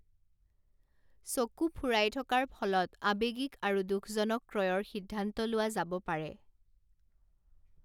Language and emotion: Assamese, neutral